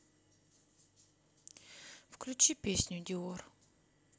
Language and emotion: Russian, sad